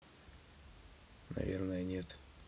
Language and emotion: Russian, neutral